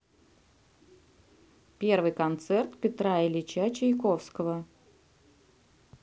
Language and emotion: Russian, neutral